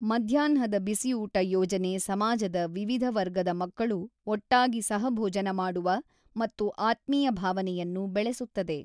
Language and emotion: Kannada, neutral